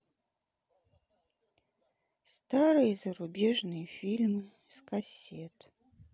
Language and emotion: Russian, sad